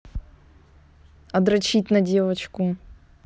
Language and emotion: Russian, neutral